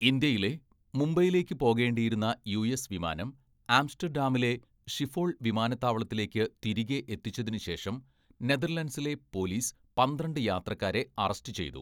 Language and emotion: Malayalam, neutral